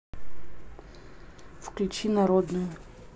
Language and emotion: Russian, neutral